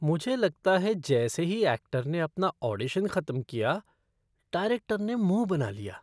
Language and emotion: Hindi, disgusted